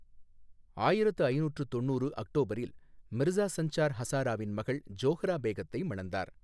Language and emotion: Tamil, neutral